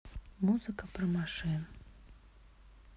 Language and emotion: Russian, sad